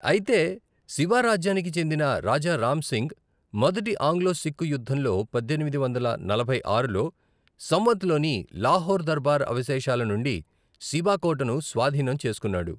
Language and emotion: Telugu, neutral